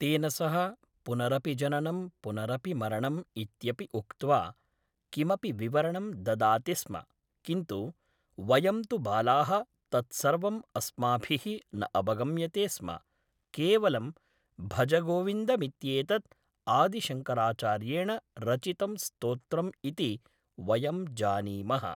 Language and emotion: Sanskrit, neutral